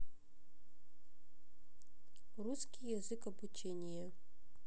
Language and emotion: Russian, neutral